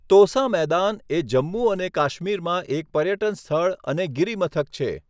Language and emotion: Gujarati, neutral